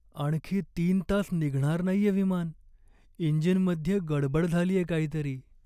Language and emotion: Marathi, sad